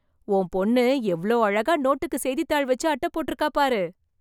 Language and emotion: Tamil, surprised